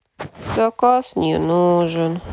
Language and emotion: Russian, sad